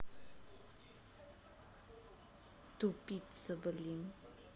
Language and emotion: Russian, angry